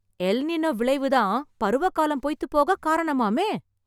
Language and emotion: Tamil, surprised